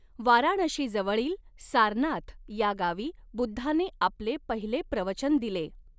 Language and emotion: Marathi, neutral